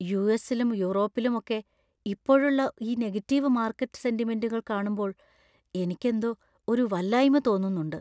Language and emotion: Malayalam, fearful